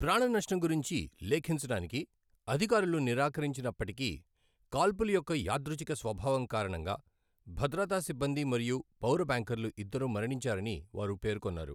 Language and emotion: Telugu, neutral